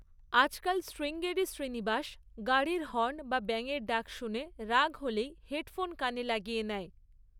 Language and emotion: Bengali, neutral